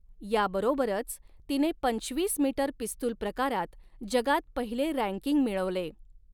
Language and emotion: Marathi, neutral